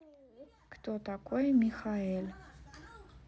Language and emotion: Russian, neutral